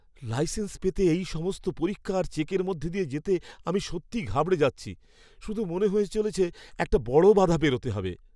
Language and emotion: Bengali, fearful